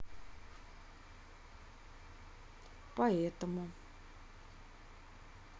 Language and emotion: Russian, neutral